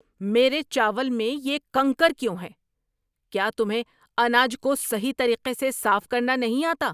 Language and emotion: Urdu, angry